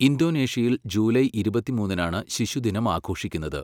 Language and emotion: Malayalam, neutral